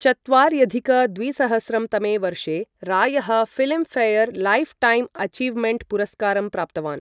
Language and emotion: Sanskrit, neutral